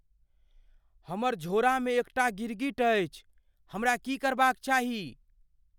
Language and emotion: Maithili, fearful